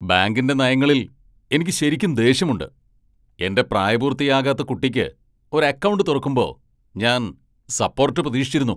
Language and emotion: Malayalam, angry